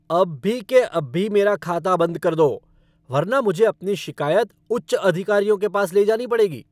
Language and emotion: Hindi, angry